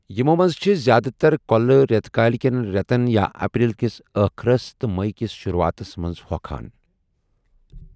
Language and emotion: Kashmiri, neutral